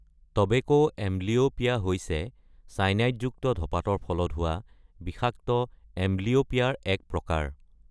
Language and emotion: Assamese, neutral